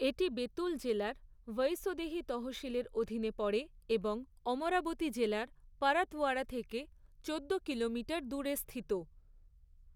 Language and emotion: Bengali, neutral